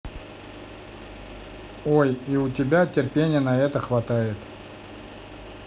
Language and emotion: Russian, neutral